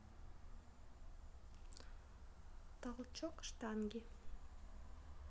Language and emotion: Russian, neutral